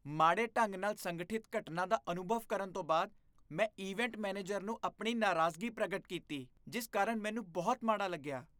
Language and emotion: Punjabi, disgusted